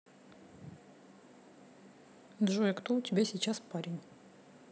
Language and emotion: Russian, neutral